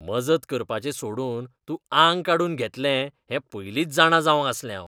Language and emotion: Goan Konkani, disgusted